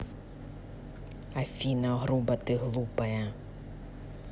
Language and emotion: Russian, angry